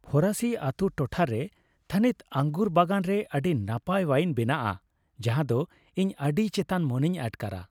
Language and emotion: Santali, happy